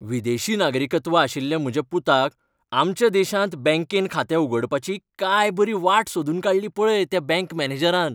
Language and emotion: Goan Konkani, happy